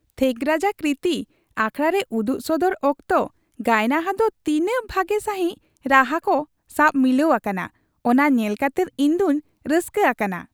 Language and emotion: Santali, happy